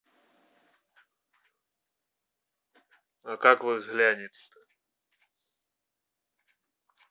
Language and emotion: Russian, neutral